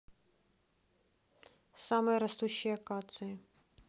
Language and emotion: Russian, neutral